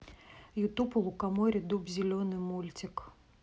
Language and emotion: Russian, neutral